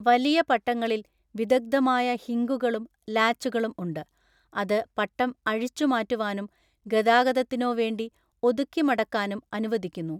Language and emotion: Malayalam, neutral